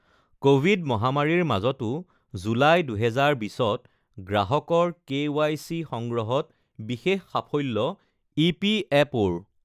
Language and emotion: Assamese, neutral